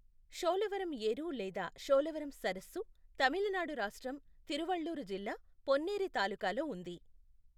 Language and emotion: Telugu, neutral